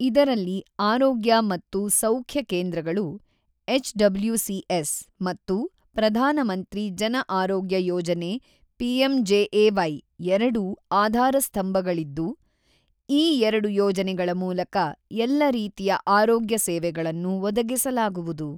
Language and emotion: Kannada, neutral